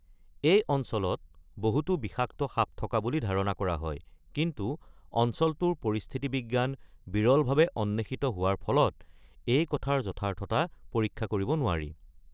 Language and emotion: Assamese, neutral